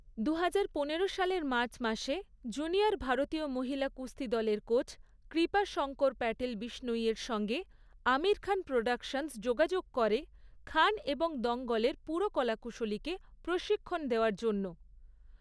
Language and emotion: Bengali, neutral